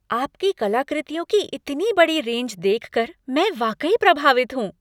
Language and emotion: Hindi, happy